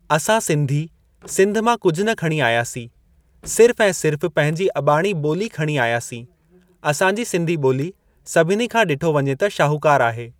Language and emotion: Sindhi, neutral